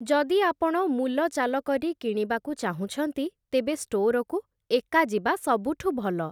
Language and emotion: Odia, neutral